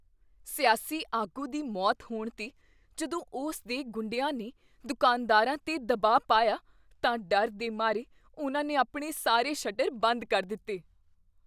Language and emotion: Punjabi, fearful